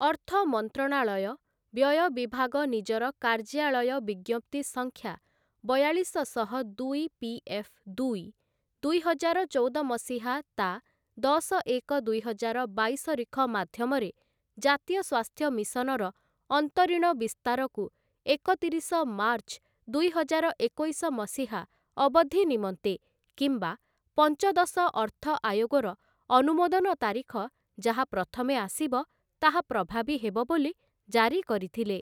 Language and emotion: Odia, neutral